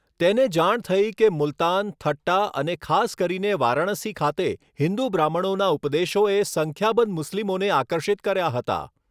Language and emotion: Gujarati, neutral